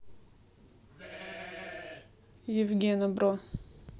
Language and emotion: Russian, neutral